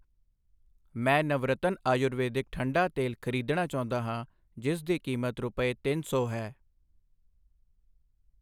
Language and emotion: Punjabi, neutral